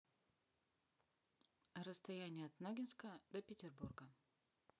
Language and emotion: Russian, neutral